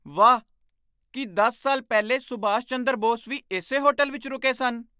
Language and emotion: Punjabi, surprised